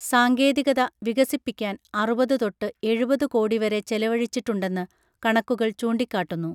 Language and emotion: Malayalam, neutral